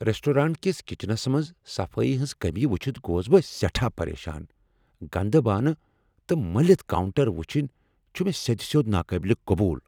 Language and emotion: Kashmiri, angry